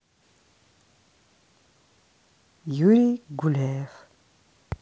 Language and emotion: Russian, neutral